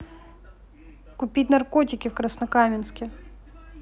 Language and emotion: Russian, neutral